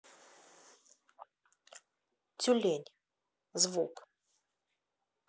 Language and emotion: Russian, neutral